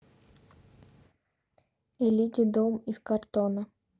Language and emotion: Russian, neutral